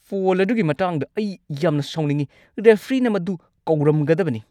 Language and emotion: Manipuri, angry